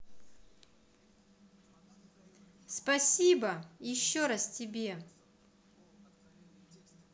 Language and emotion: Russian, positive